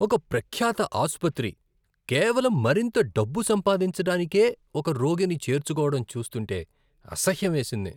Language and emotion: Telugu, disgusted